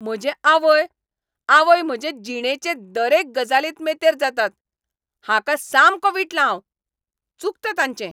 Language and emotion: Goan Konkani, angry